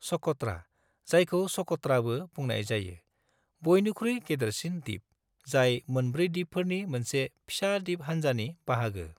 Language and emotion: Bodo, neutral